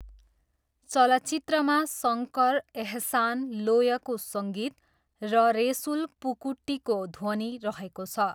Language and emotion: Nepali, neutral